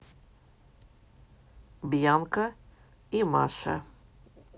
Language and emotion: Russian, neutral